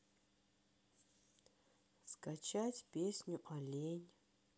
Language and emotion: Russian, neutral